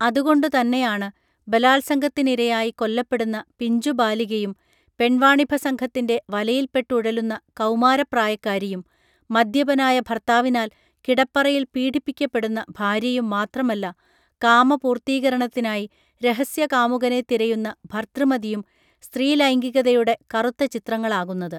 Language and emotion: Malayalam, neutral